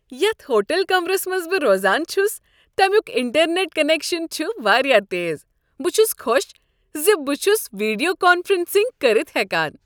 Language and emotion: Kashmiri, happy